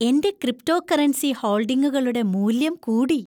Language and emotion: Malayalam, happy